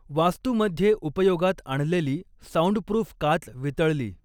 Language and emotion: Marathi, neutral